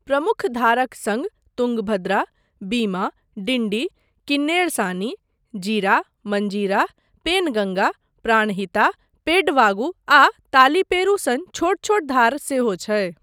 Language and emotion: Maithili, neutral